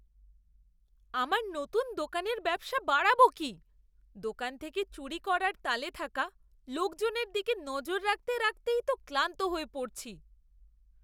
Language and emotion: Bengali, disgusted